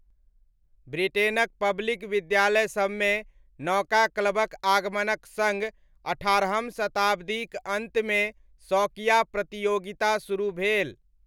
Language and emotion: Maithili, neutral